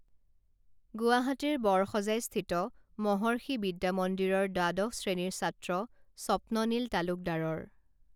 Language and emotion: Assamese, neutral